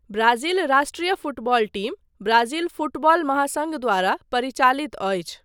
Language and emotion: Maithili, neutral